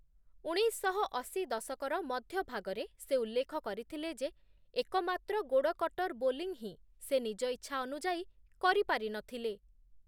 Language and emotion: Odia, neutral